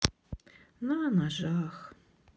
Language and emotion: Russian, sad